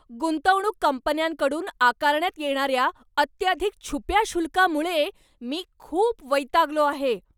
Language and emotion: Marathi, angry